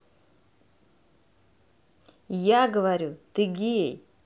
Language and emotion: Russian, neutral